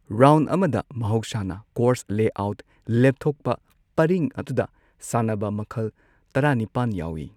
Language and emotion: Manipuri, neutral